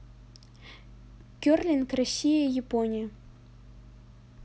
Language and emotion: Russian, neutral